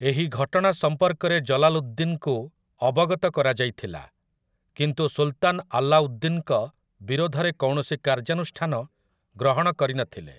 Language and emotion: Odia, neutral